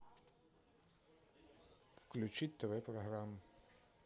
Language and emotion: Russian, neutral